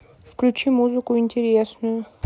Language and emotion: Russian, neutral